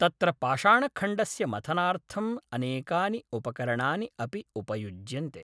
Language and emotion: Sanskrit, neutral